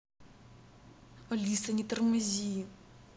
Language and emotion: Russian, angry